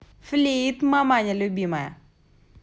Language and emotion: Russian, positive